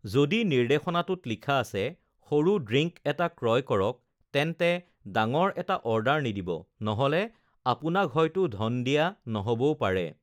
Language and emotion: Assamese, neutral